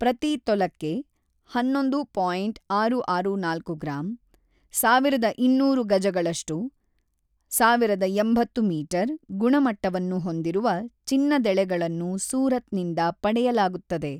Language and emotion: Kannada, neutral